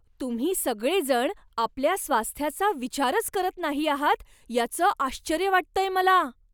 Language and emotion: Marathi, surprised